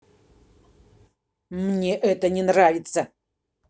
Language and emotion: Russian, angry